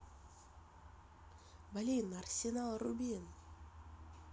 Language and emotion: Russian, positive